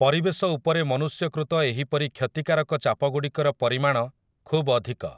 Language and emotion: Odia, neutral